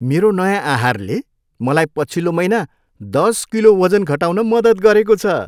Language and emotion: Nepali, happy